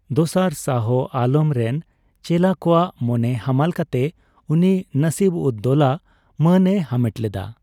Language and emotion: Santali, neutral